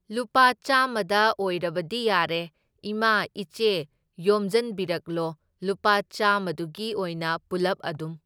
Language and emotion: Manipuri, neutral